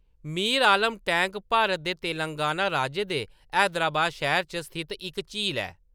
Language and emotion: Dogri, neutral